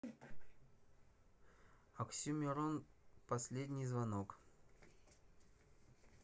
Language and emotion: Russian, neutral